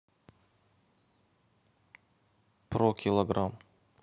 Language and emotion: Russian, neutral